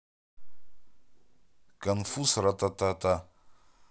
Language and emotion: Russian, neutral